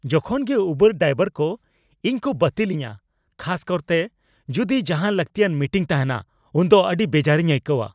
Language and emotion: Santali, angry